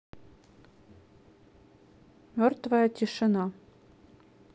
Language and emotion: Russian, neutral